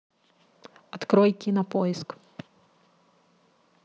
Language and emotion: Russian, neutral